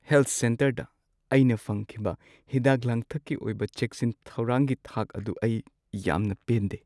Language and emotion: Manipuri, sad